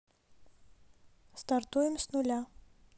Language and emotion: Russian, neutral